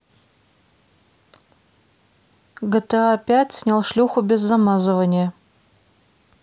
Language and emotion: Russian, neutral